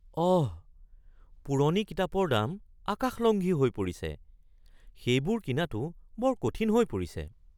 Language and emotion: Assamese, surprised